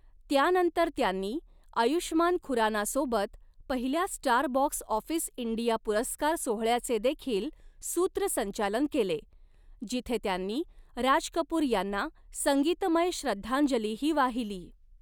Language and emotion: Marathi, neutral